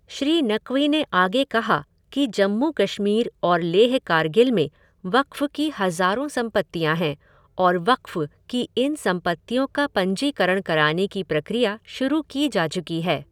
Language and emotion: Hindi, neutral